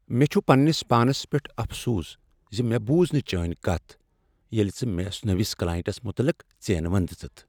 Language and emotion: Kashmiri, sad